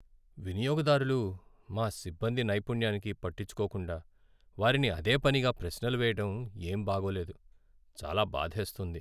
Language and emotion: Telugu, sad